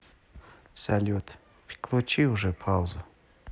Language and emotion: Russian, neutral